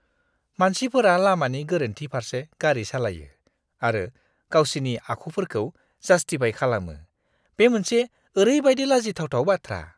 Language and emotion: Bodo, disgusted